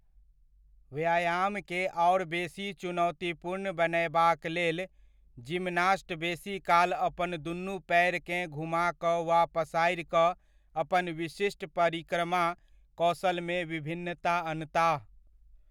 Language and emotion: Maithili, neutral